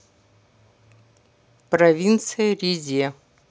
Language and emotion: Russian, neutral